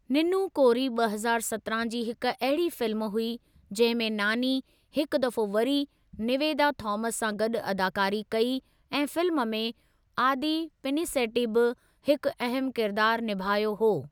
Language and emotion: Sindhi, neutral